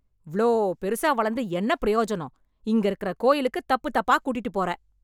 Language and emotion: Tamil, angry